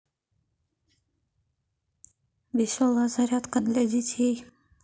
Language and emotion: Russian, neutral